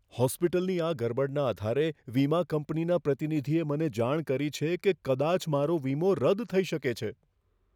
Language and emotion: Gujarati, fearful